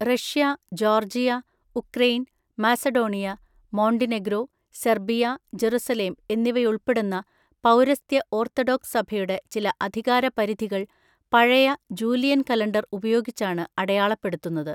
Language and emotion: Malayalam, neutral